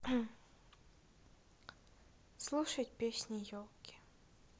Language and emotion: Russian, sad